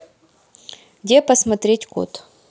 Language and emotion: Russian, neutral